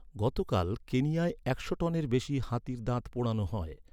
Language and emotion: Bengali, neutral